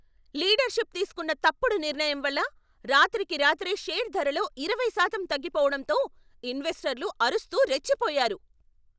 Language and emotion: Telugu, angry